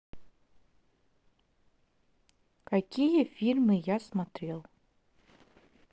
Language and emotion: Russian, neutral